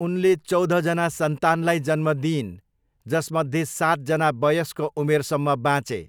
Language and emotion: Nepali, neutral